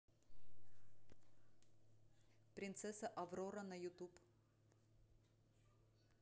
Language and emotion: Russian, neutral